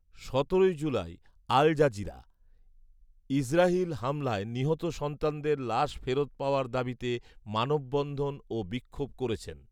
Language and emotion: Bengali, neutral